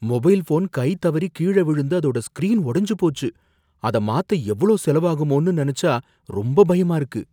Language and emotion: Tamil, fearful